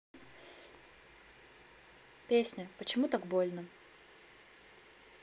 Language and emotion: Russian, neutral